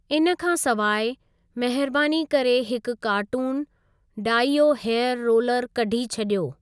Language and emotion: Sindhi, neutral